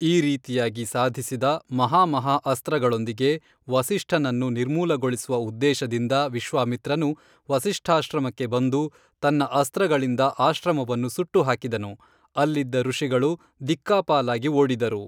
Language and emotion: Kannada, neutral